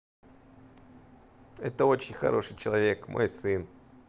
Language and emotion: Russian, positive